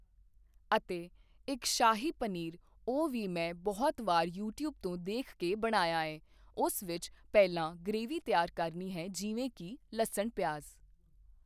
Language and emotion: Punjabi, neutral